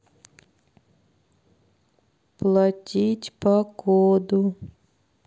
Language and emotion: Russian, sad